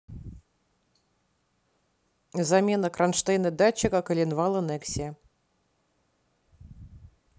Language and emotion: Russian, neutral